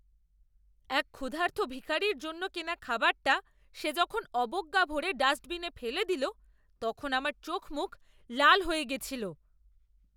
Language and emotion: Bengali, angry